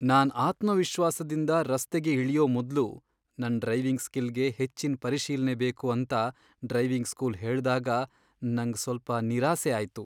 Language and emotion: Kannada, sad